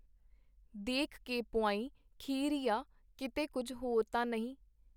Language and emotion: Punjabi, neutral